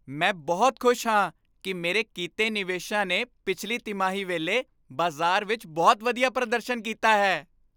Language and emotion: Punjabi, happy